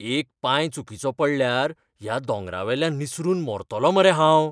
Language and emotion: Goan Konkani, fearful